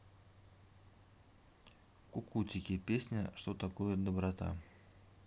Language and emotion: Russian, neutral